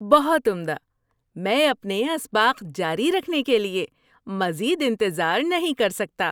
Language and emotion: Urdu, happy